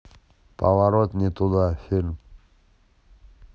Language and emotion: Russian, neutral